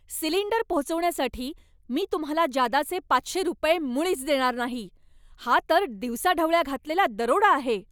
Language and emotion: Marathi, angry